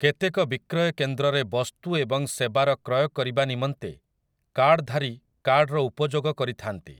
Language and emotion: Odia, neutral